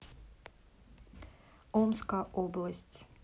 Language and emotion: Russian, neutral